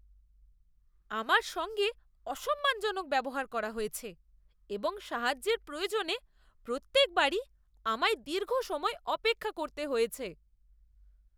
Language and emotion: Bengali, disgusted